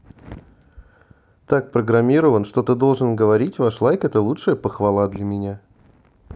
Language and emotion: Russian, neutral